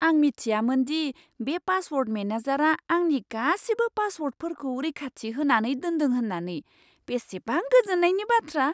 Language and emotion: Bodo, surprised